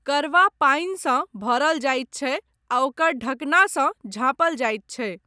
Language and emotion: Maithili, neutral